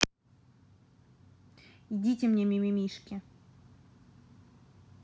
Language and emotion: Russian, neutral